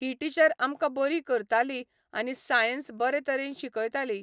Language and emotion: Goan Konkani, neutral